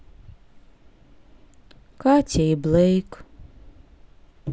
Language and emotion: Russian, sad